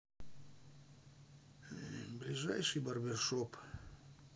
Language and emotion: Russian, sad